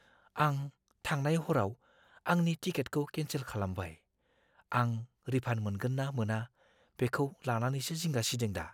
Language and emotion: Bodo, fearful